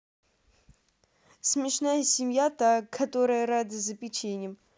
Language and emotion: Russian, positive